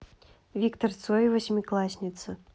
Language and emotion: Russian, neutral